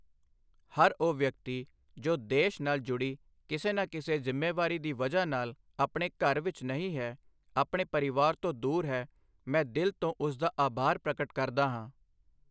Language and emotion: Punjabi, neutral